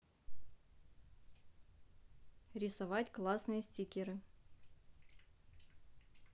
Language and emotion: Russian, neutral